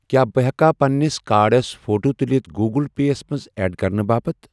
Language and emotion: Kashmiri, neutral